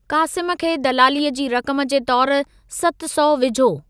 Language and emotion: Sindhi, neutral